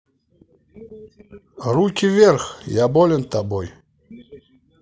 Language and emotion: Russian, positive